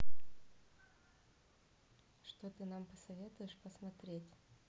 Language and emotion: Russian, neutral